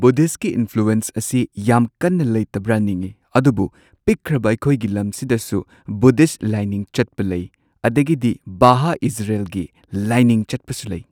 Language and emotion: Manipuri, neutral